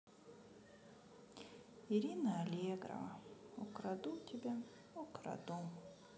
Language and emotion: Russian, sad